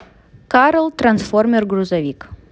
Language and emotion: Russian, neutral